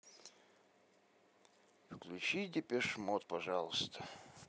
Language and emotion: Russian, sad